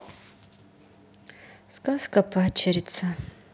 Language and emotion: Russian, sad